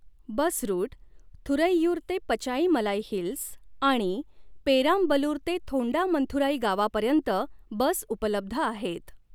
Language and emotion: Marathi, neutral